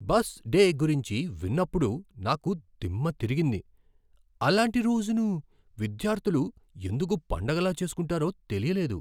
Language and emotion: Telugu, surprised